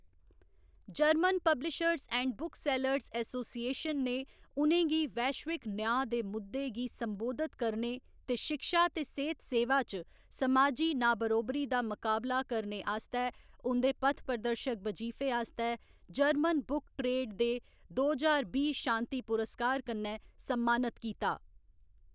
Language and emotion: Dogri, neutral